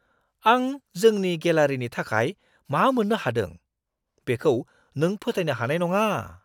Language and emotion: Bodo, surprised